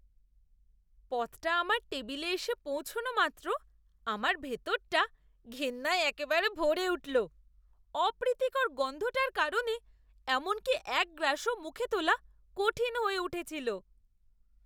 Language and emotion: Bengali, disgusted